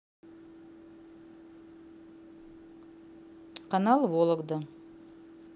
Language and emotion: Russian, neutral